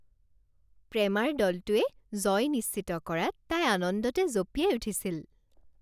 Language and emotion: Assamese, happy